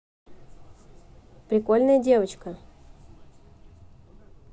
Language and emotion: Russian, neutral